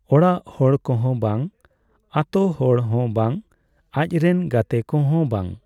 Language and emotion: Santali, neutral